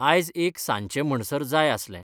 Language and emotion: Goan Konkani, neutral